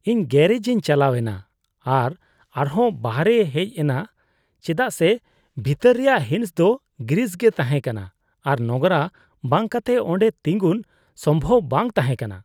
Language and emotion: Santali, disgusted